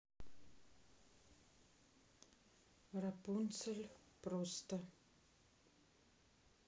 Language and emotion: Russian, neutral